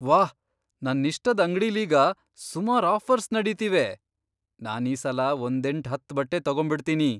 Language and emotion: Kannada, surprised